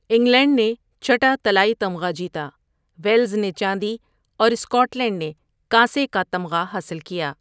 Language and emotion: Urdu, neutral